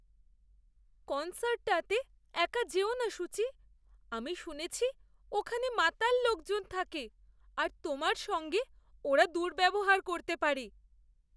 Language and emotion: Bengali, fearful